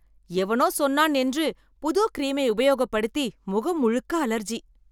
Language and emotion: Tamil, angry